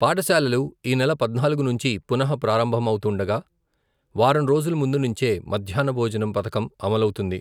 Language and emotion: Telugu, neutral